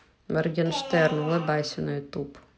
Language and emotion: Russian, neutral